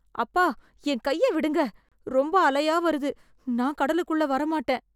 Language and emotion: Tamil, fearful